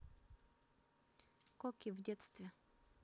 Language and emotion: Russian, neutral